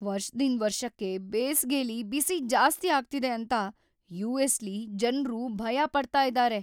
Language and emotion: Kannada, fearful